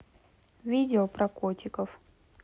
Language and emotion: Russian, neutral